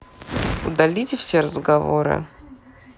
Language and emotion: Russian, neutral